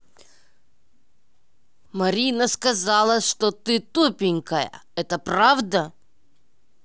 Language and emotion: Russian, angry